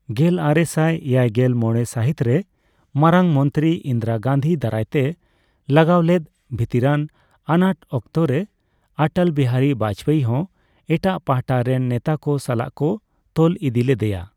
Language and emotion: Santali, neutral